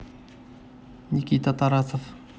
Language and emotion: Russian, neutral